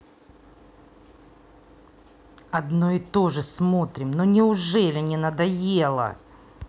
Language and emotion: Russian, angry